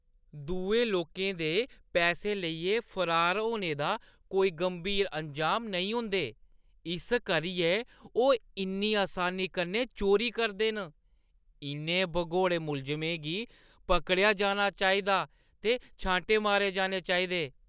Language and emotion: Dogri, disgusted